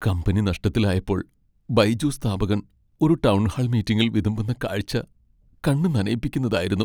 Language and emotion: Malayalam, sad